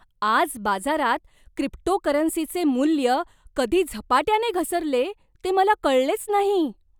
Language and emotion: Marathi, surprised